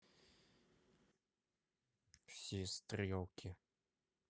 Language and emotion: Russian, neutral